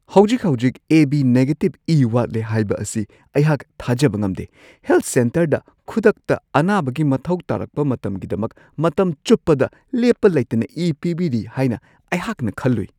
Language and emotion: Manipuri, surprised